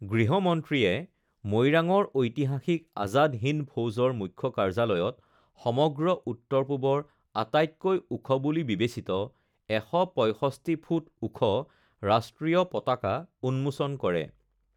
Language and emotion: Assamese, neutral